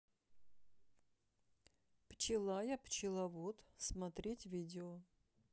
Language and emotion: Russian, neutral